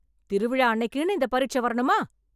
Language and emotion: Tamil, angry